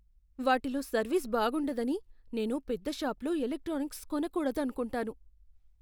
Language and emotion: Telugu, fearful